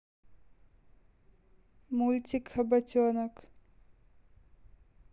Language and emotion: Russian, neutral